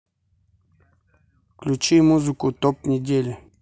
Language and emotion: Russian, neutral